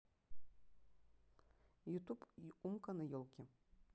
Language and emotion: Russian, neutral